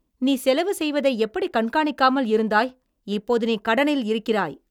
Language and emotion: Tamil, angry